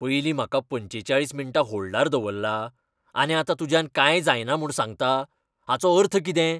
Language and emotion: Goan Konkani, angry